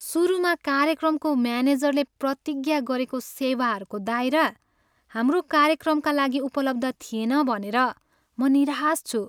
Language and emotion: Nepali, sad